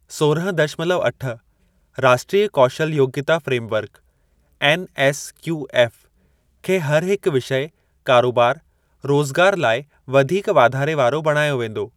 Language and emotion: Sindhi, neutral